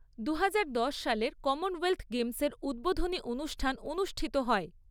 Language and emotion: Bengali, neutral